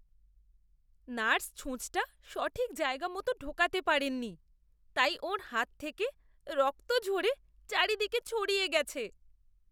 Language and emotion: Bengali, disgusted